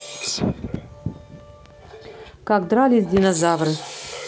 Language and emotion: Russian, neutral